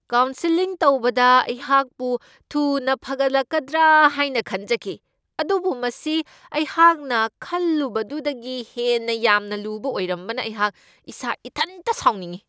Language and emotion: Manipuri, angry